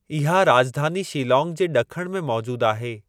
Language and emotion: Sindhi, neutral